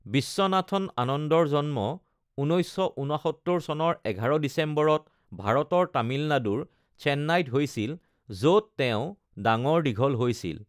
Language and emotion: Assamese, neutral